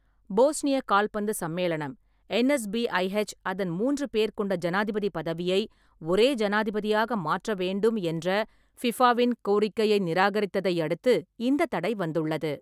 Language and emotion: Tamil, neutral